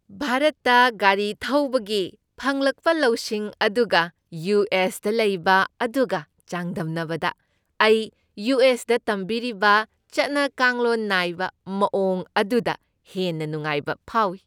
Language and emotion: Manipuri, happy